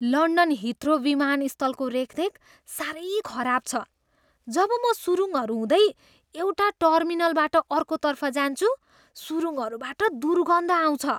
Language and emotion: Nepali, disgusted